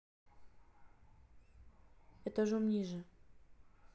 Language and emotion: Russian, neutral